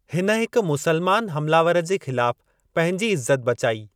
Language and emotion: Sindhi, neutral